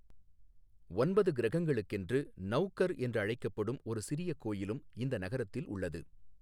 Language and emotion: Tamil, neutral